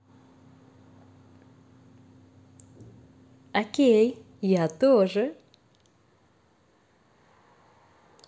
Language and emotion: Russian, positive